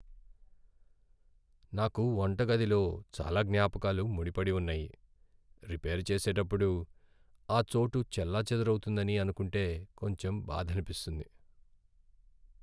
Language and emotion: Telugu, sad